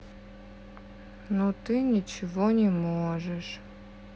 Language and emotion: Russian, sad